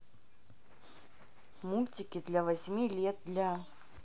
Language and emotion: Russian, neutral